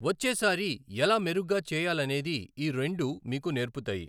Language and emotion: Telugu, neutral